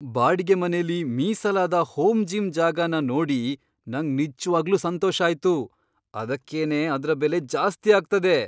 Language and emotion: Kannada, surprised